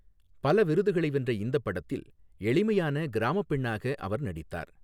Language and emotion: Tamil, neutral